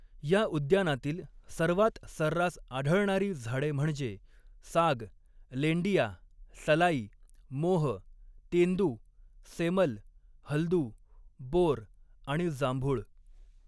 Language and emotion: Marathi, neutral